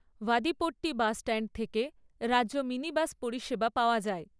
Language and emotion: Bengali, neutral